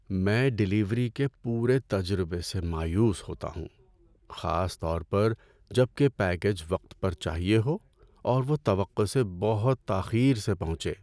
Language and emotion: Urdu, sad